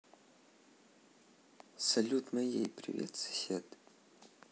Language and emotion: Russian, neutral